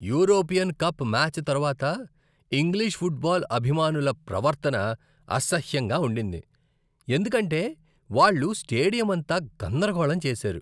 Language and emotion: Telugu, disgusted